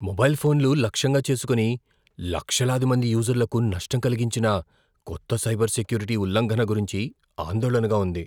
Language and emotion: Telugu, fearful